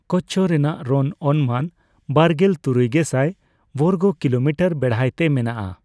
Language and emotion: Santali, neutral